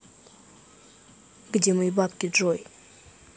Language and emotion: Russian, neutral